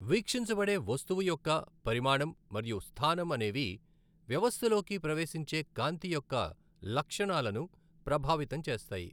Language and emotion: Telugu, neutral